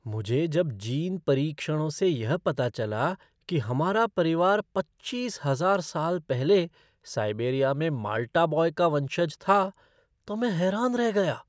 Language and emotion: Hindi, surprised